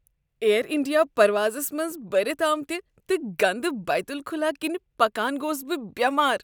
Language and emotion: Kashmiri, disgusted